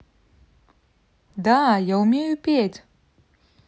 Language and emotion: Russian, positive